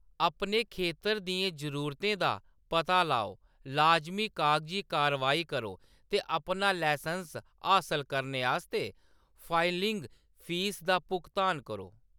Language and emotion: Dogri, neutral